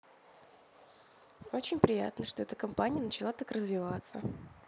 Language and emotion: Russian, neutral